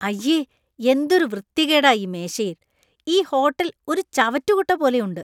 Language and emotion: Malayalam, disgusted